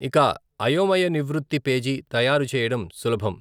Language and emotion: Telugu, neutral